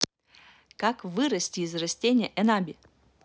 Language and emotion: Russian, positive